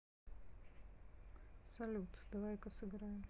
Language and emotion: Russian, neutral